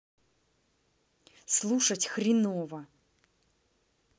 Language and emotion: Russian, angry